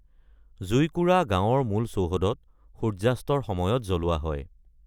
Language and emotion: Assamese, neutral